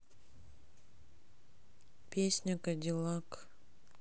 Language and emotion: Russian, sad